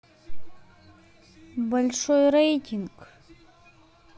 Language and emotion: Russian, neutral